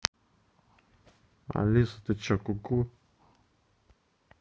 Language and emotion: Russian, neutral